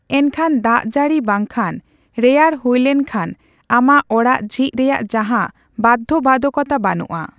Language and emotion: Santali, neutral